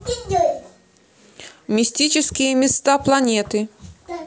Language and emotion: Russian, neutral